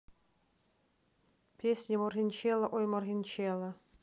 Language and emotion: Russian, neutral